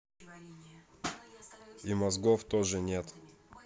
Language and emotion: Russian, neutral